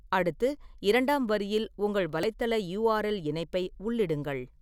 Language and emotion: Tamil, neutral